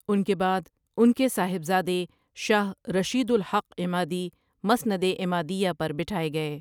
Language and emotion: Urdu, neutral